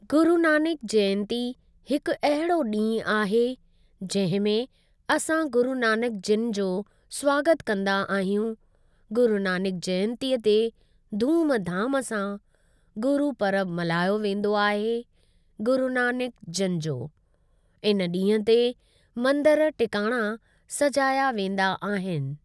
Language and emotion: Sindhi, neutral